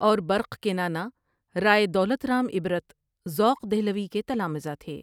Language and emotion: Urdu, neutral